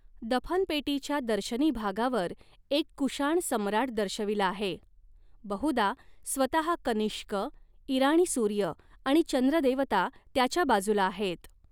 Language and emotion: Marathi, neutral